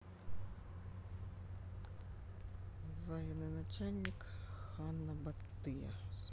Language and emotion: Russian, neutral